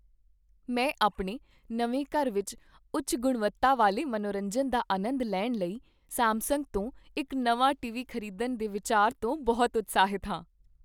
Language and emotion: Punjabi, happy